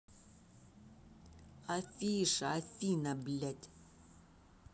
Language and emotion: Russian, angry